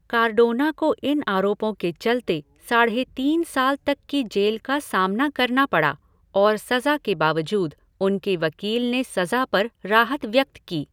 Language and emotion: Hindi, neutral